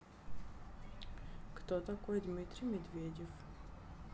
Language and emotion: Russian, neutral